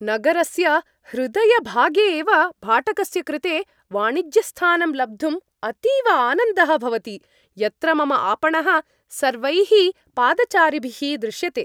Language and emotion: Sanskrit, happy